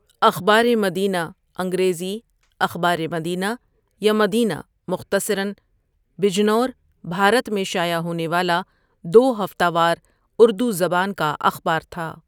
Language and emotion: Urdu, neutral